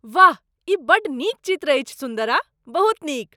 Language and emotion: Maithili, surprised